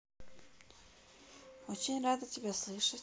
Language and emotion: Russian, neutral